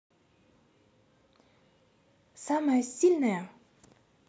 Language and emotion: Russian, neutral